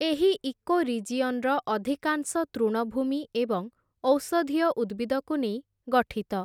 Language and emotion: Odia, neutral